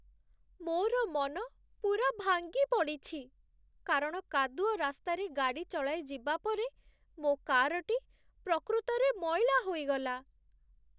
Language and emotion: Odia, sad